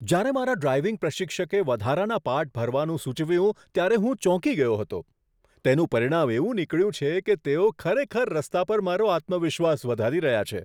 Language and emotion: Gujarati, surprised